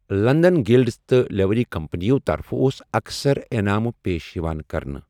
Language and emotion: Kashmiri, neutral